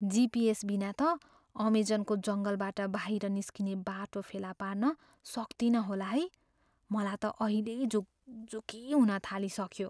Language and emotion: Nepali, fearful